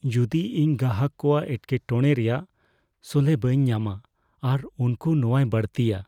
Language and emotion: Santali, fearful